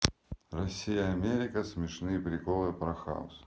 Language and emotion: Russian, neutral